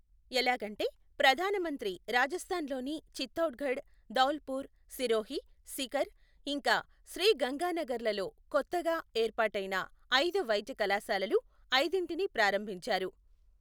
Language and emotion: Telugu, neutral